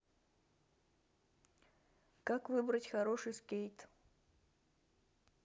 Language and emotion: Russian, neutral